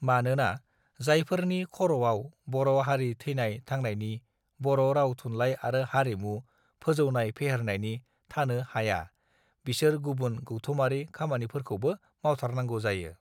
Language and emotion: Bodo, neutral